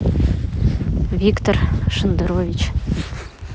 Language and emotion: Russian, neutral